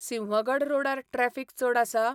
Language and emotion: Goan Konkani, neutral